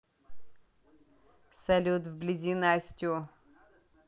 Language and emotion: Russian, neutral